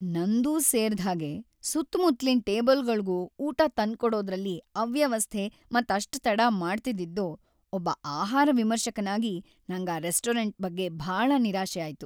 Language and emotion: Kannada, sad